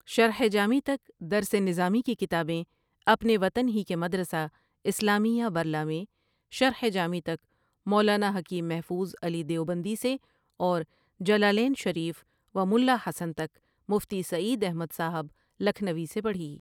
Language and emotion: Urdu, neutral